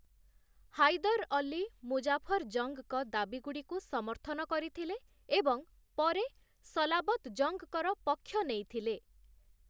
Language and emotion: Odia, neutral